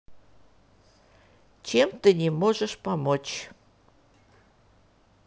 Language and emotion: Russian, neutral